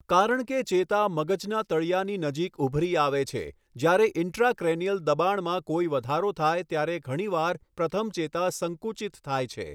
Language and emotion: Gujarati, neutral